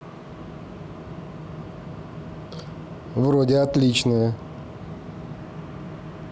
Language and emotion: Russian, positive